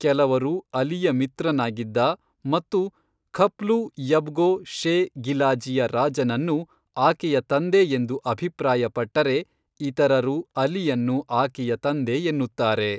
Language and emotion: Kannada, neutral